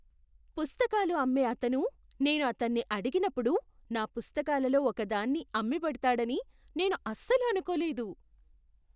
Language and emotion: Telugu, surprised